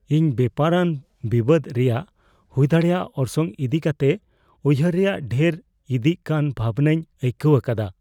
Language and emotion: Santali, fearful